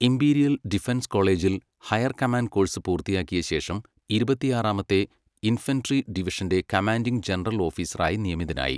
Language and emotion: Malayalam, neutral